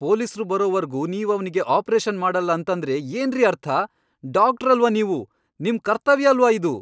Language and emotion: Kannada, angry